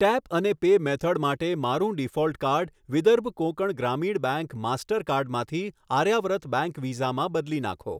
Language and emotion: Gujarati, neutral